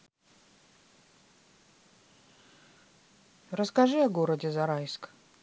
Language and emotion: Russian, neutral